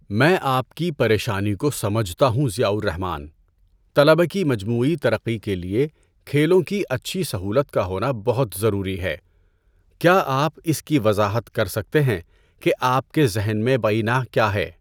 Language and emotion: Urdu, neutral